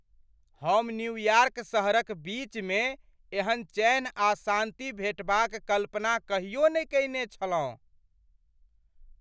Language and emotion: Maithili, surprised